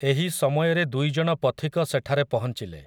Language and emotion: Odia, neutral